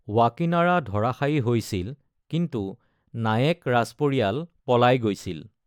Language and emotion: Assamese, neutral